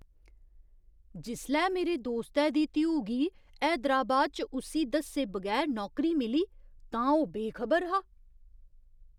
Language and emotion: Dogri, surprised